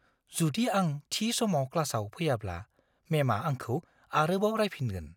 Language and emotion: Bodo, fearful